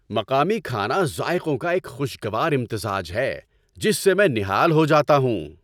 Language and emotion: Urdu, happy